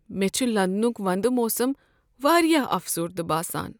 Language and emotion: Kashmiri, sad